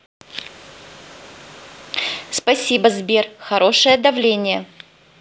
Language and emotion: Russian, neutral